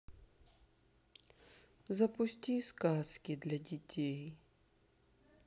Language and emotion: Russian, sad